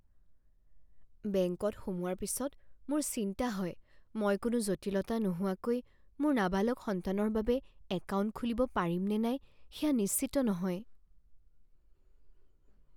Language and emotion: Assamese, fearful